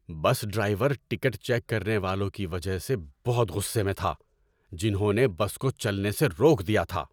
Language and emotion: Urdu, angry